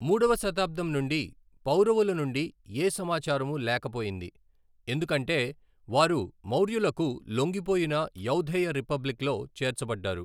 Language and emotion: Telugu, neutral